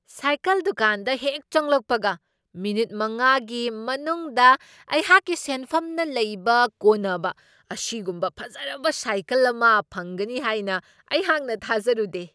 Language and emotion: Manipuri, surprised